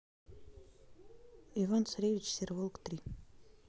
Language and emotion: Russian, neutral